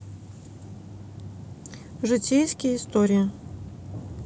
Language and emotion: Russian, neutral